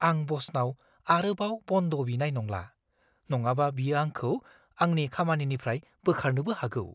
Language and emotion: Bodo, fearful